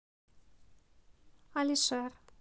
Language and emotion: Russian, neutral